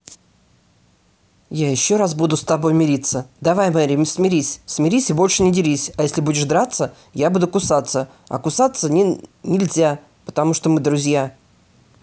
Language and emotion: Russian, angry